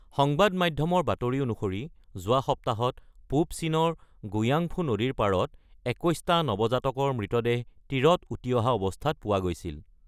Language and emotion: Assamese, neutral